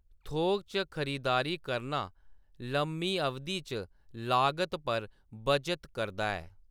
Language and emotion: Dogri, neutral